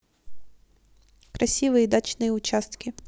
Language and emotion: Russian, neutral